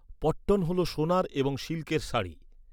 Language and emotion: Bengali, neutral